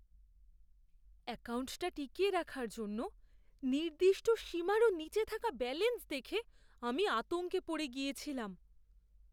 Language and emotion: Bengali, fearful